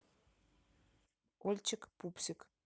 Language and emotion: Russian, neutral